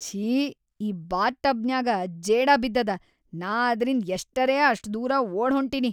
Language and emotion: Kannada, disgusted